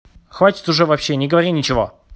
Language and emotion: Russian, angry